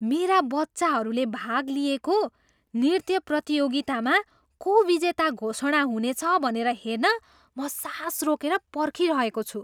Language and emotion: Nepali, surprised